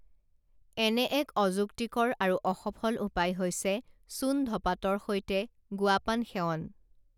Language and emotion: Assamese, neutral